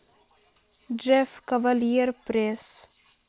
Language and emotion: Russian, sad